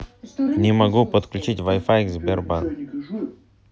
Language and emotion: Russian, neutral